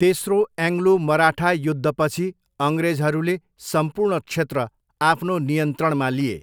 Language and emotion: Nepali, neutral